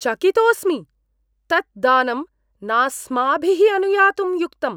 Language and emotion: Sanskrit, disgusted